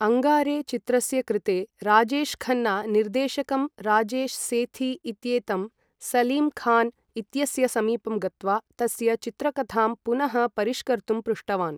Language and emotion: Sanskrit, neutral